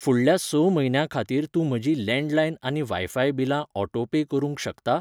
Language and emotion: Goan Konkani, neutral